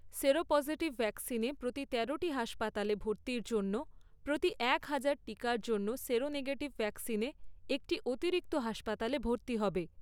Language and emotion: Bengali, neutral